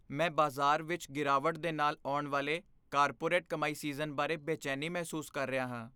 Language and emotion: Punjabi, fearful